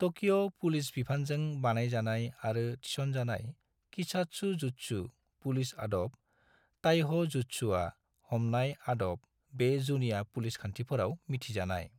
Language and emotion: Bodo, neutral